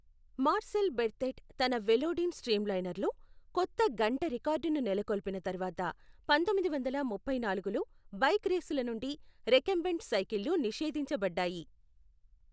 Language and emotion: Telugu, neutral